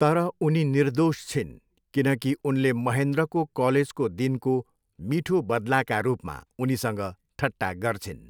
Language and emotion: Nepali, neutral